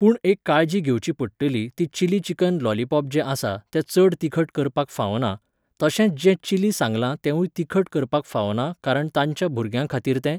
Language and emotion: Goan Konkani, neutral